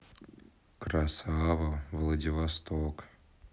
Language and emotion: Russian, neutral